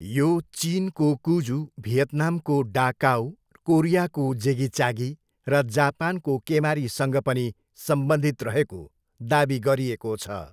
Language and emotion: Nepali, neutral